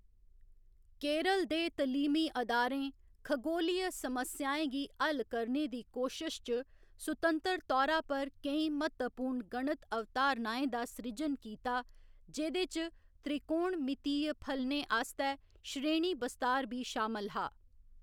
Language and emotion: Dogri, neutral